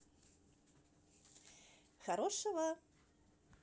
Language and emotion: Russian, positive